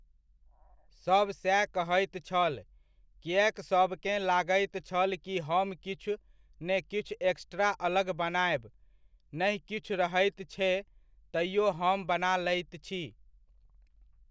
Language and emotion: Maithili, neutral